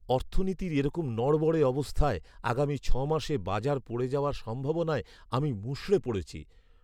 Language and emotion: Bengali, sad